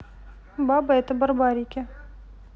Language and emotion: Russian, neutral